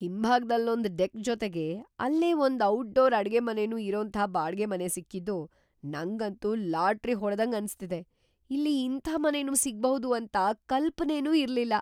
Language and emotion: Kannada, surprised